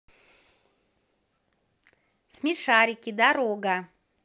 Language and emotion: Russian, positive